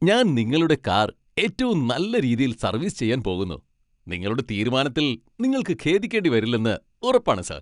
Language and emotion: Malayalam, happy